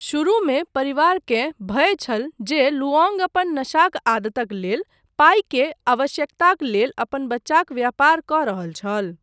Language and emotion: Maithili, neutral